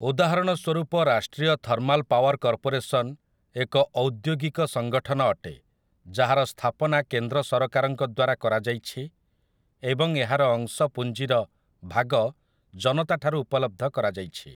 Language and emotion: Odia, neutral